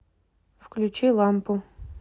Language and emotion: Russian, neutral